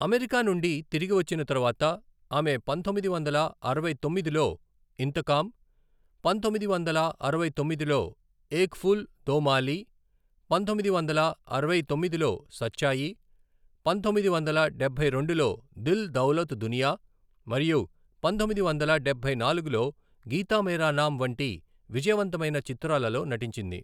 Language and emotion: Telugu, neutral